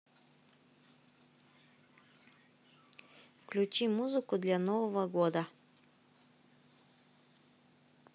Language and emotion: Russian, neutral